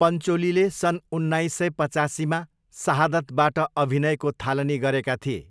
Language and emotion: Nepali, neutral